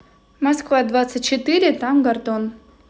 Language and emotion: Russian, neutral